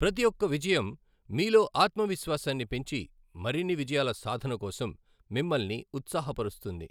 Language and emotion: Telugu, neutral